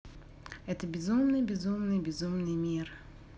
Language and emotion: Russian, neutral